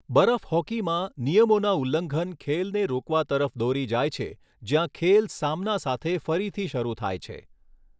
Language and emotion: Gujarati, neutral